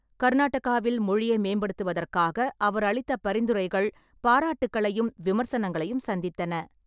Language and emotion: Tamil, neutral